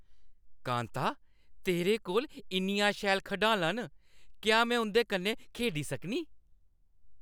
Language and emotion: Dogri, happy